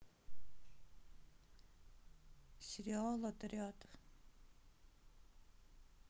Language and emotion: Russian, neutral